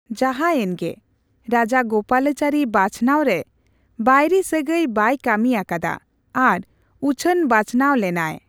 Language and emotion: Santali, neutral